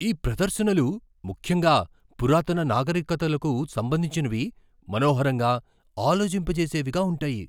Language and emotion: Telugu, surprised